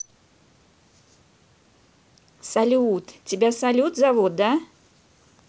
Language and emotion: Russian, positive